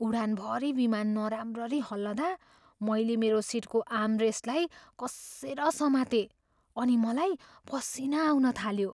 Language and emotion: Nepali, fearful